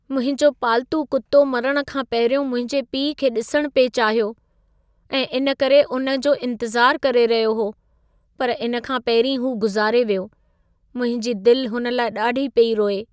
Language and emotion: Sindhi, sad